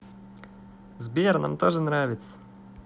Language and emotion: Russian, positive